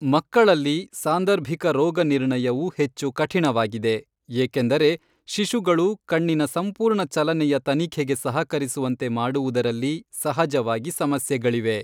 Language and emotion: Kannada, neutral